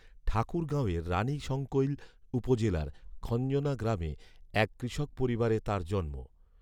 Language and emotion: Bengali, neutral